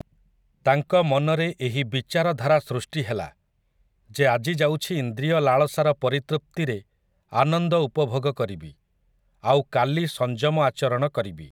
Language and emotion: Odia, neutral